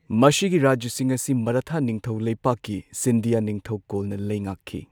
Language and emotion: Manipuri, neutral